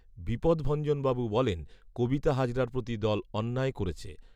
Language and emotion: Bengali, neutral